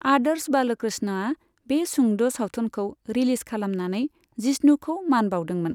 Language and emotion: Bodo, neutral